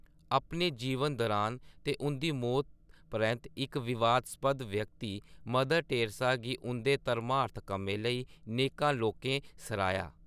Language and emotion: Dogri, neutral